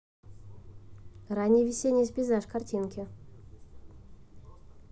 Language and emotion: Russian, neutral